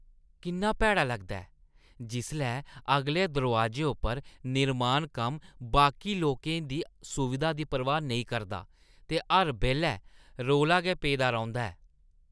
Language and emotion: Dogri, disgusted